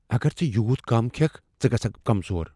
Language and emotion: Kashmiri, fearful